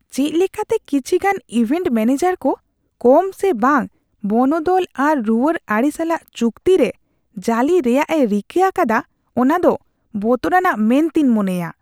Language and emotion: Santali, disgusted